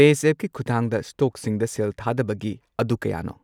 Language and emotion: Manipuri, neutral